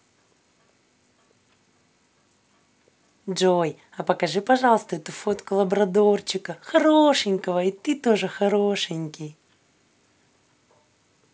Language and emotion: Russian, positive